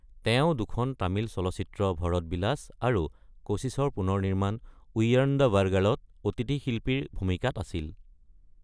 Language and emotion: Assamese, neutral